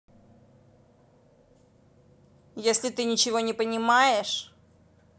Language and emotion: Russian, angry